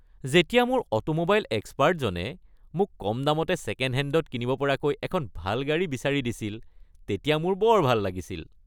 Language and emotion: Assamese, happy